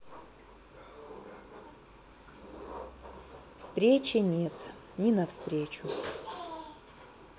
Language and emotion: Russian, sad